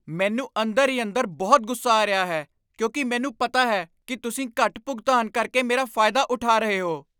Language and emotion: Punjabi, angry